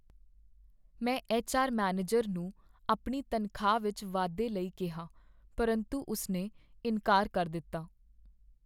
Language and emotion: Punjabi, sad